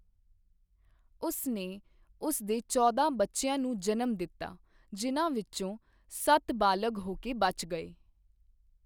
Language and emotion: Punjabi, neutral